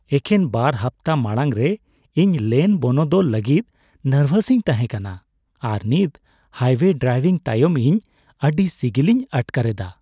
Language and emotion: Santali, happy